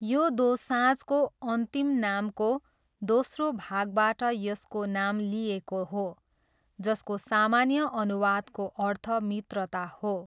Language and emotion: Nepali, neutral